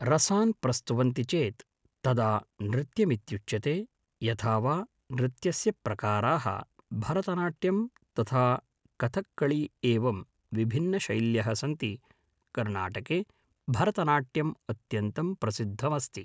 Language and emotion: Sanskrit, neutral